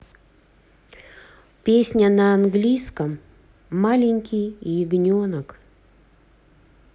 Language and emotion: Russian, neutral